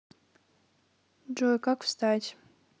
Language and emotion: Russian, neutral